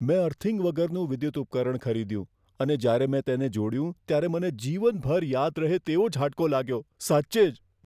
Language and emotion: Gujarati, fearful